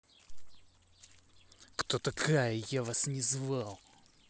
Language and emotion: Russian, angry